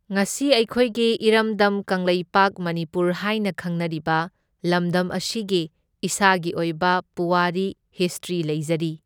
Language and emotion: Manipuri, neutral